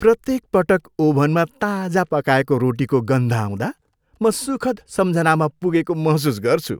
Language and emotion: Nepali, happy